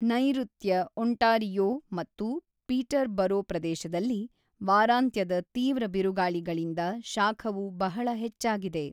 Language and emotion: Kannada, neutral